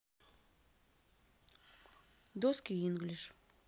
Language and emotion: Russian, neutral